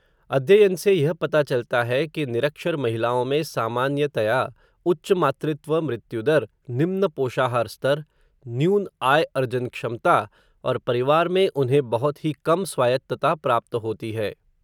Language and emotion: Hindi, neutral